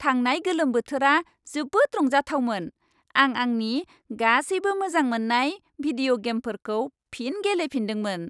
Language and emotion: Bodo, happy